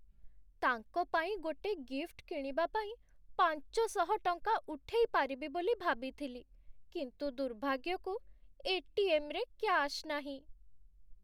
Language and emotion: Odia, sad